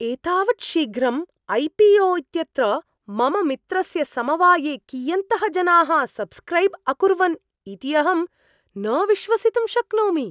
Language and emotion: Sanskrit, surprised